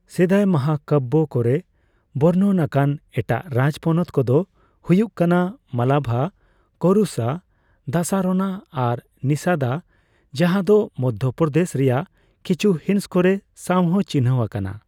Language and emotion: Santali, neutral